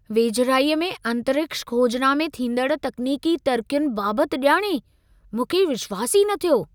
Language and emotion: Sindhi, surprised